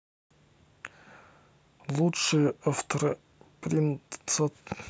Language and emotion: Russian, neutral